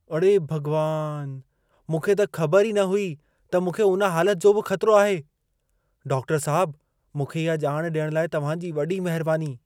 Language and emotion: Sindhi, surprised